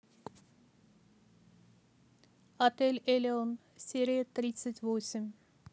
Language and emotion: Russian, neutral